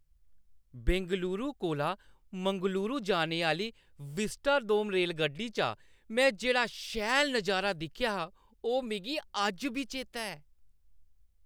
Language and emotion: Dogri, happy